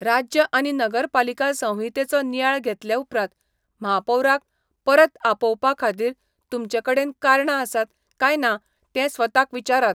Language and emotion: Goan Konkani, neutral